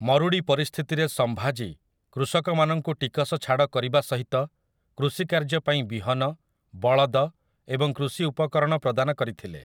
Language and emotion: Odia, neutral